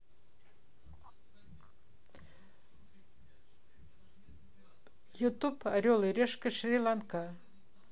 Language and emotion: Russian, neutral